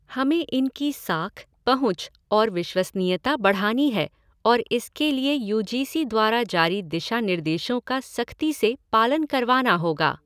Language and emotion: Hindi, neutral